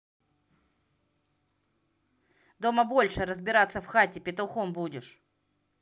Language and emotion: Russian, angry